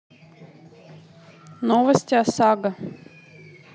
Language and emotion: Russian, neutral